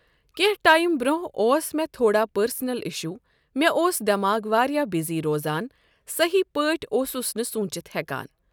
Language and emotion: Kashmiri, neutral